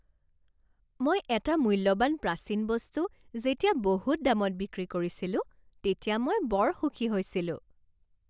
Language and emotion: Assamese, happy